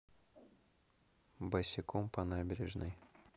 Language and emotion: Russian, neutral